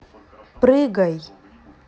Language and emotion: Russian, neutral